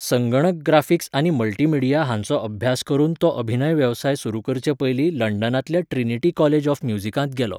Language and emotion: Goan Konkani, neutral